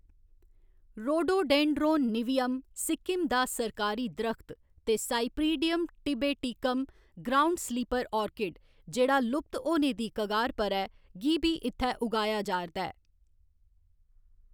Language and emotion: Dogri, neutral